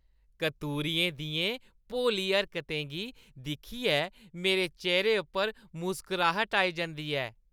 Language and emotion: Dogri, happy